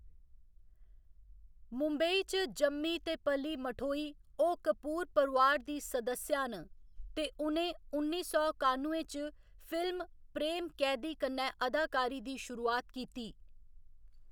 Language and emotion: Dogri, neutral